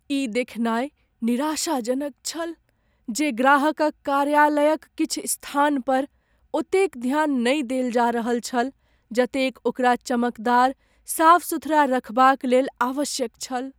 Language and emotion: Maithili, sad